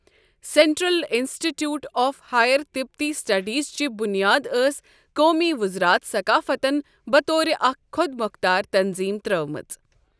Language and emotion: Kashmiri, neutral